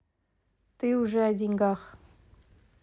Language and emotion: Russian, neutral